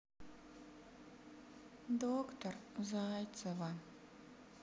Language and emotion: Russian, sad